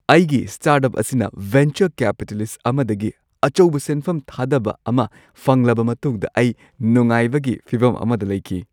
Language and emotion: Manipuri, happy